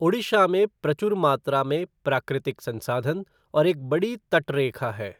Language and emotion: Hindi, neutral